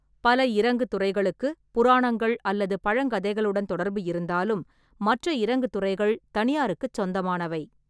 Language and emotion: Tamil, neutral